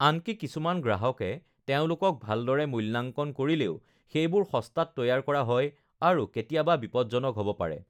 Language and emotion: Assamese, neutral